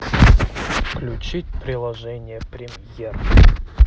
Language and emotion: Russian, neutral